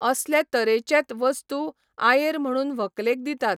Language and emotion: Goan Konkani, neutral